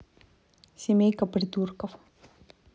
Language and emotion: Russian, neutral